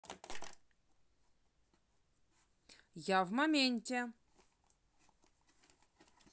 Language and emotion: Russian, positive